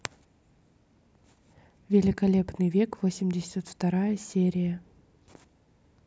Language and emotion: Russian, neutral